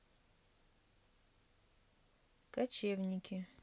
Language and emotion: Russian, neutral